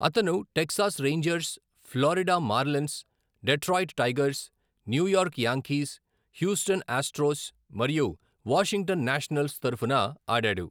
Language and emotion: Telugu, neutral